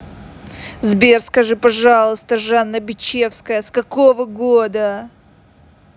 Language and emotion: Russian, angry